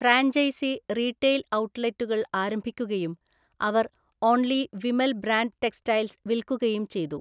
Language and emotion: Malayalam, neutral